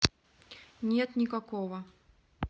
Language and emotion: Russian, neutral